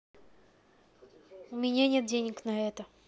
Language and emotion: Russian, neutral